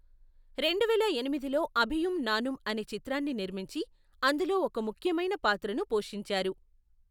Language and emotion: Telugu, neutral